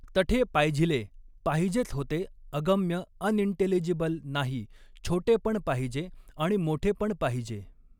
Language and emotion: Marathi, neutral